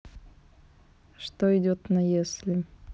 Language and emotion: Russian, neutral